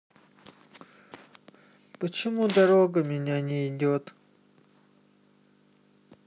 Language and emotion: Russian, sad